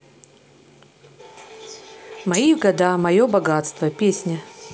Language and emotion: Russian, neutral